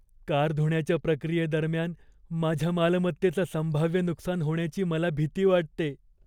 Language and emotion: Marathi, fearful